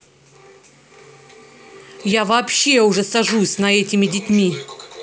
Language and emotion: Russian, angry